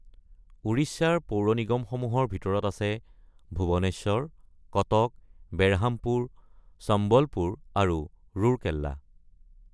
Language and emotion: Assamese, neutral